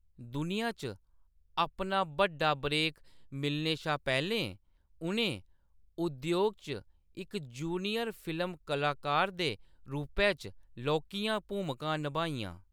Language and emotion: Dogri, neutral